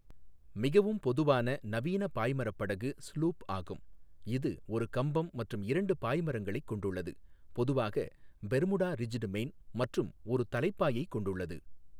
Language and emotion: Tamil, neutral